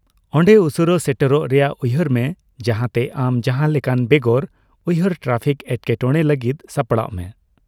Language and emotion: Santali, neutral